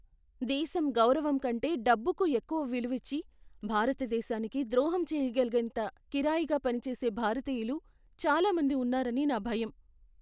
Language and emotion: Telugu, fearful